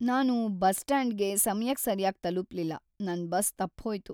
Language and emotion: Kannada, sad